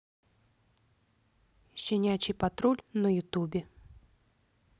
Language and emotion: Russian, neutral